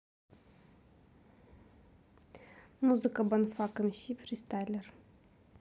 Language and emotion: Russian, neutral